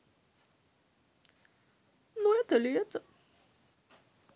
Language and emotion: Russian, sad